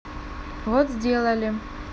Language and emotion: Russian, neutral